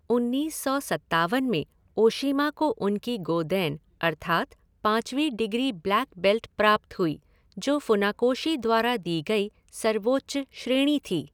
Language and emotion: Hindi, neutral